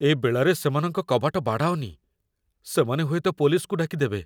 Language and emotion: Odia, fearful